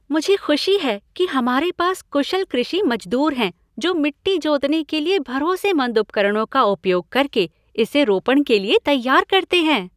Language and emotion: Hindi, happy